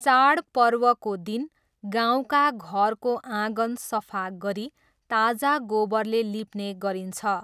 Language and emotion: Nepali, neutral